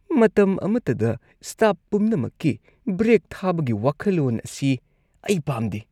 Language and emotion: Manipuri, disgusted